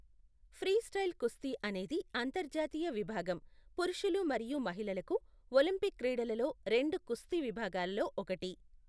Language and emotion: Telugu, neutral